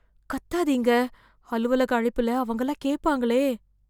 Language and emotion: Tamil, fearful